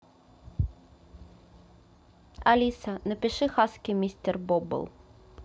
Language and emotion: Russian, neutral